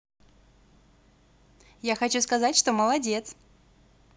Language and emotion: Russian, positive